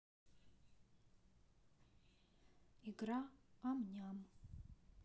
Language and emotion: Russian, neutral